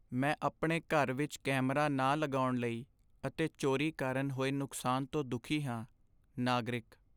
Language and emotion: Punjabi, sad